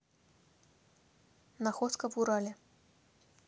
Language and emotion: Russian, neutral